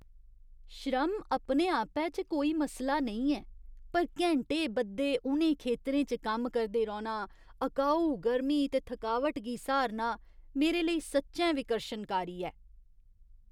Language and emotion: Dogri, disgusted